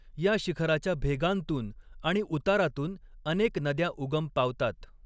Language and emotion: Marathi, neutral